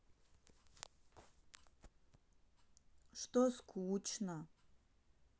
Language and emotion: Russian, sad